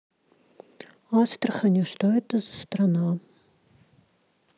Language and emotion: Russian, neutral